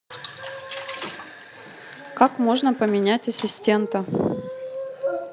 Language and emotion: Russian, neutral